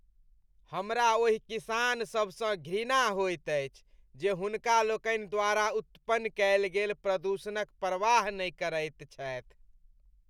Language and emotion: Maithili, disgusted